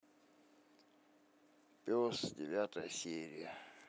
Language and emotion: Russian, sad